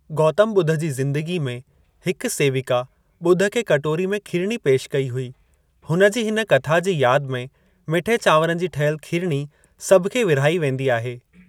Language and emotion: Sindhi, neutral